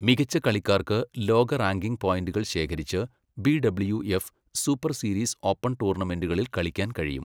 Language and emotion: Malayalam, neutral